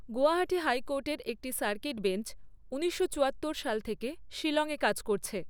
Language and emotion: Bengali, neutral